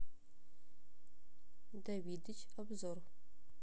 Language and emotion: Russian, neutral